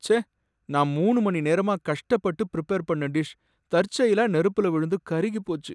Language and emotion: Tamil, sad